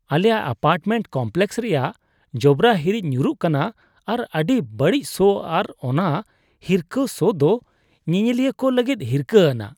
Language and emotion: Santali, disgusted